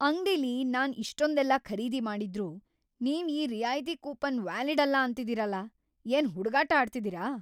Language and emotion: Kannada, angry